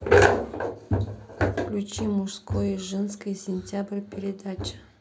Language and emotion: Russian, neutral